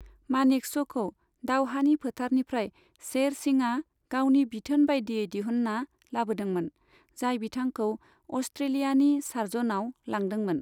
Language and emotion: Bodo, neutral